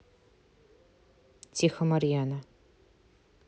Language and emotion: Russian, neutral